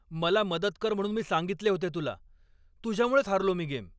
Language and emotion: Marathi, angry